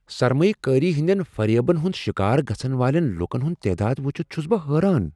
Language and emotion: Kashmiri, surprised